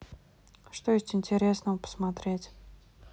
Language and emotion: Russian, neutral